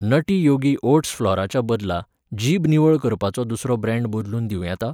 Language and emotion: Goan Konkani, neutral